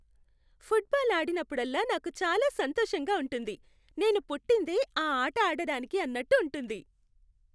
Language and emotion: Telugu, happy